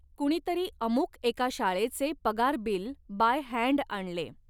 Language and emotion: Marathi, neutral